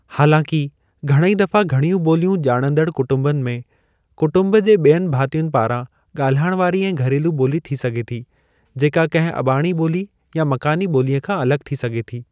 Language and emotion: Sindhi, neutral